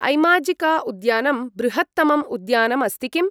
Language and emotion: Sanskrit, neutral